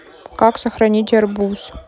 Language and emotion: Russian, neutral